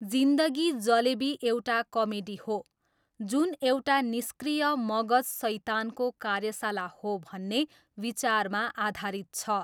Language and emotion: Nepali, neutral